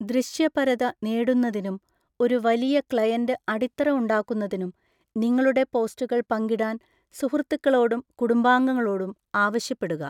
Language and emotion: Malayalam, neutral